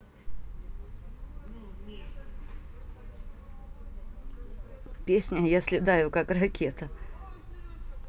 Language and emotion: Russian, positive